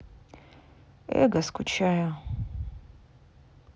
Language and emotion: Russian, sad